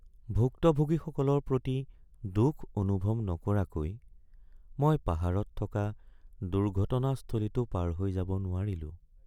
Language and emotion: Assamese, sad